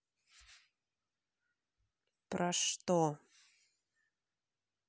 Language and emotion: Russian, angry